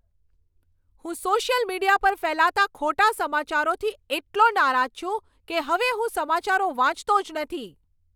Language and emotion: Gujarati, angry